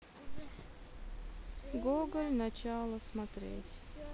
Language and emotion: Russian, sad